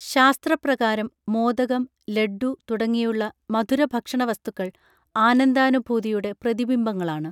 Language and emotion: Malayalam, neutral